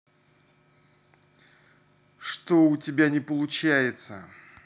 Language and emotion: Russian, angry